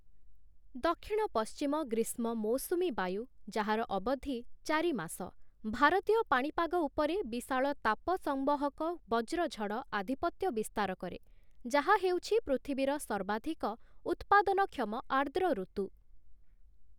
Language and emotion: Odia, neutral